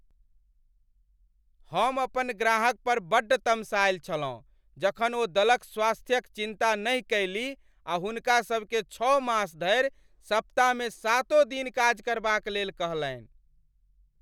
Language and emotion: Maithili, angry